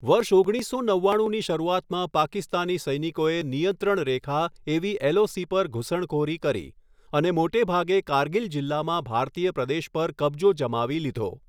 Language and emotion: Gujarati, neutral